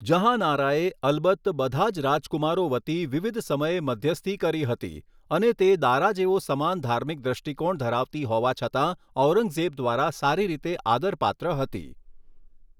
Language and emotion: Gujarati, neutral